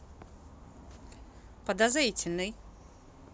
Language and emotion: Russian, neutral